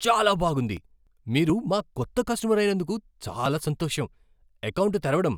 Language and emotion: Telugu, surprised